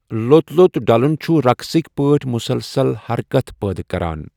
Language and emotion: Kashmiri, neutral